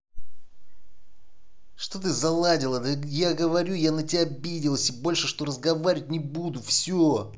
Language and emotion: Russian, angry